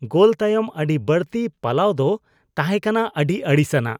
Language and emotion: Santali, disgusted